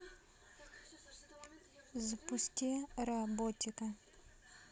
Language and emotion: Russian, neutral